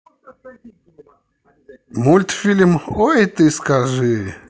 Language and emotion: Russian, positive